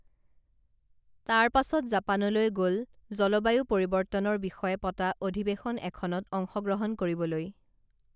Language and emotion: Assamese, neutral